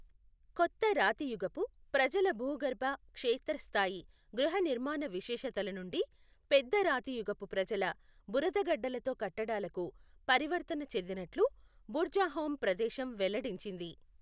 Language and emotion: Telugu, neutral